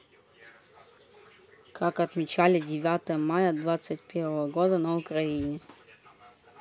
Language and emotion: Russian, neutral